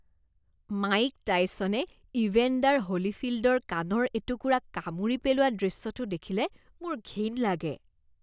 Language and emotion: Assamese, disgusted